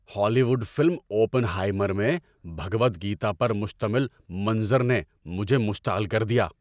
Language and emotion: Urdu, angry